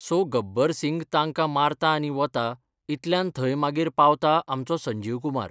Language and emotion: Goan Konkani, neutral